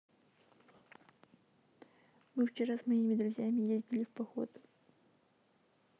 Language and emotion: Russian, neutral